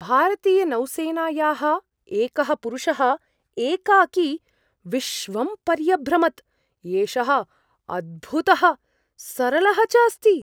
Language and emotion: Sanskrit, surprised